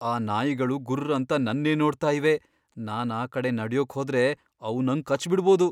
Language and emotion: Kannada, fearful